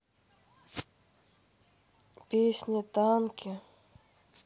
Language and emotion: Russian, sad